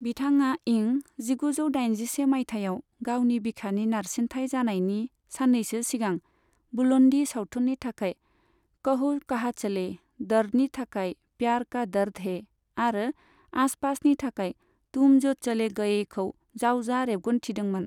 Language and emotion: Bodo, neutral